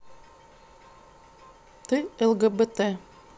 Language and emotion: Russian, neutral